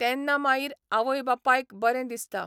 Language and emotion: Goan Konkani, neutral